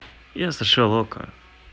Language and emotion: Russian, neutral